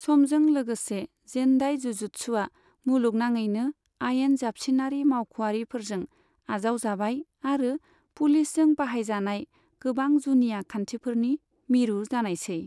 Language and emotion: Bodo, neutral